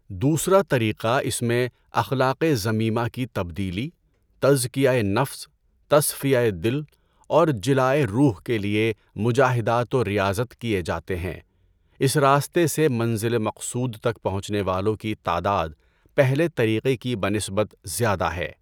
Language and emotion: Urdu, neutral